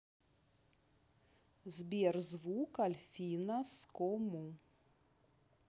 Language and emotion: Russian, neutral